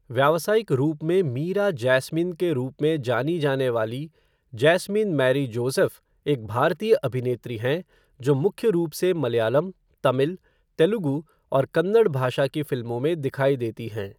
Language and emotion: Hindi, neutral